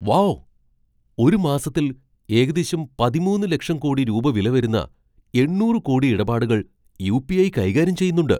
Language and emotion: Malayalam, surprised